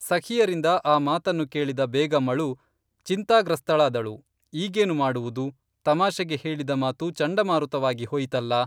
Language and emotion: Kannada, neutral